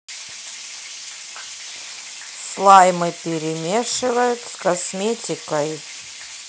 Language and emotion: Russian, neutral